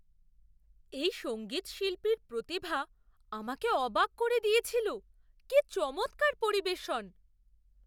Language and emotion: Bengali, surprised